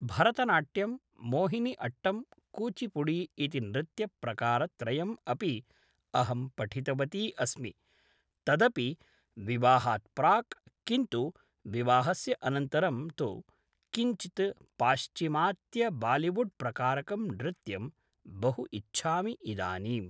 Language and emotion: Sanskrit, neutral